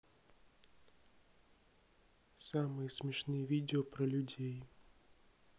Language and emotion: Russian, neutral